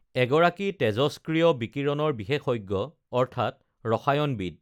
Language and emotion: Assamese, neutral